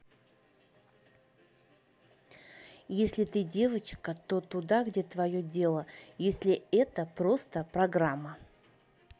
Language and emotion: Russian, neutral